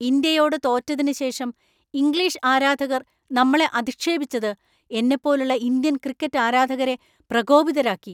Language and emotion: Malayalam, angry